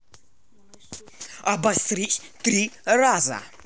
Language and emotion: Russian, angry